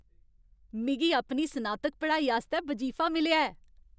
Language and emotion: Dogri, happy